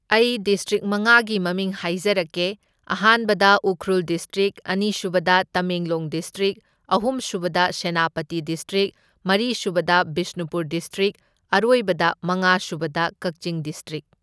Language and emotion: Manipuri, neutral